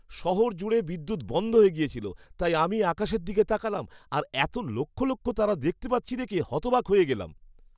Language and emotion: Bengali, surprised